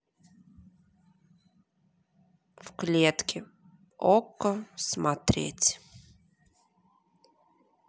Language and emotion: Russian, neutral